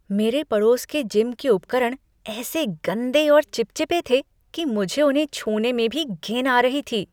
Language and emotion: Hindi, disgusted